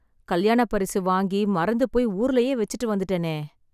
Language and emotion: Tamil, sad